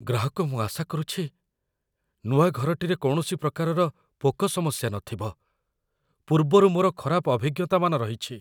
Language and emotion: Odia, fearful